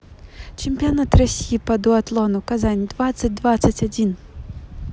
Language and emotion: Russian, neutral